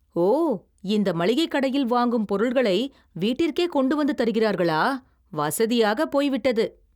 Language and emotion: Tamil, surprised